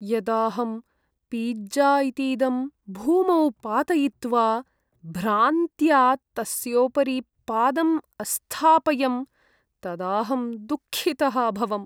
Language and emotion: Sanskrit, sad